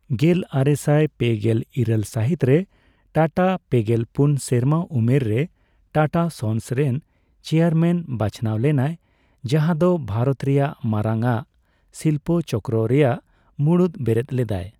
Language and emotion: Santali, neutral